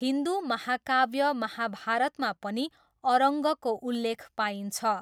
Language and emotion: Nepali, neutral